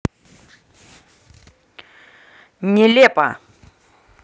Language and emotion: Russian, angry